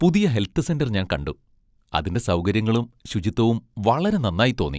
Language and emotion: Malayalam, happy